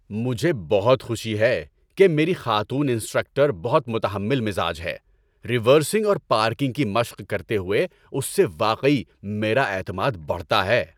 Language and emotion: Urdu, happy